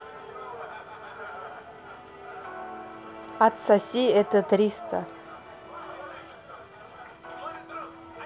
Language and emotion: Russian, neutral